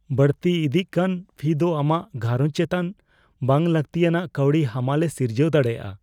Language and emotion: Santali, fearful